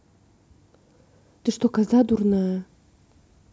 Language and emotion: Russian, angry